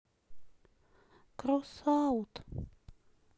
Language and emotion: Russian, sad